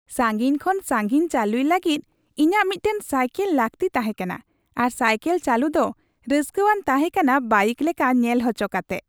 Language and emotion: Santali, happy